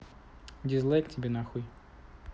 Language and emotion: Russian, neutral